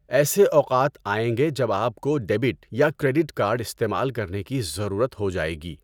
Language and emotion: Urdu, neutral